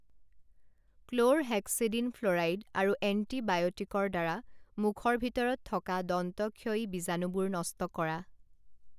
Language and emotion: Assamese, neutral